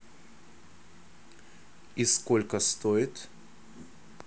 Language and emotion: Russian, neutral